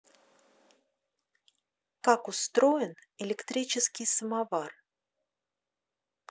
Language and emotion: Russian, neutral